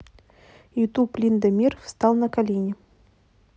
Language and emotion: Russian, neutral